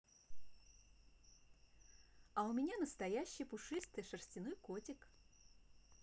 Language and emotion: Russian, positive